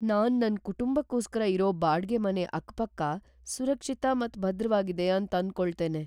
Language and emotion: Kannada, fearful